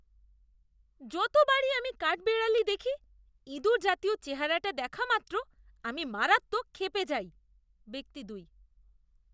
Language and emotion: Bengali, disgusted